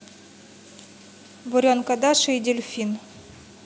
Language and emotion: Russian, neutral